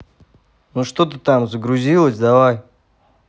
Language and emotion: Russian, neutral